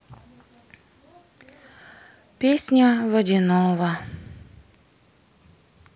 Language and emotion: Russian, sad